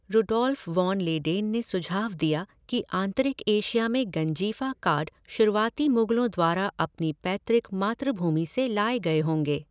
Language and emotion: Hindi, neutral